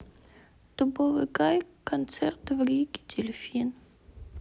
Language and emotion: Russian, sad